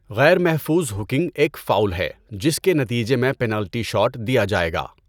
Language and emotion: Urdu, neutral